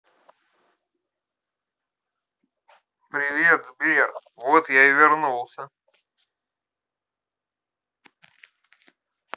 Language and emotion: Russian, positive